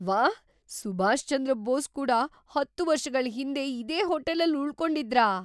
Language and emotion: Kannada, surprised